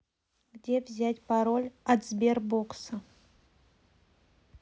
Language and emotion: Russian, neutral